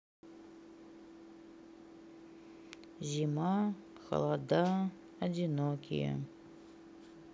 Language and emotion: Russian, sad